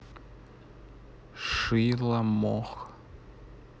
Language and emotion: Russian, neutral